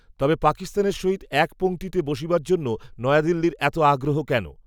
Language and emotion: Bengali, neutral